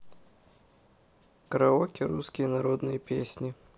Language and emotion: Russian, neutral